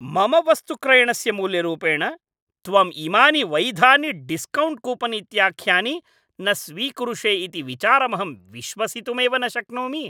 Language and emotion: Sanskrit, angry